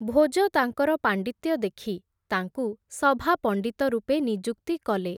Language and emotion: Odia, neutral